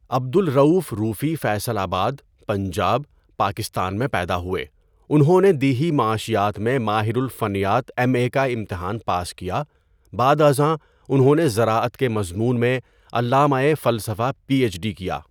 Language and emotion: Urdu, neutral